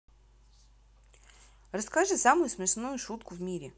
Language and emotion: Russian, neutral